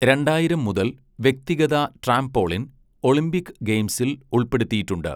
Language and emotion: Malayalam, neutral